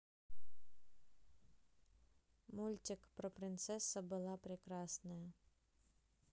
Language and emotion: Russian, neutral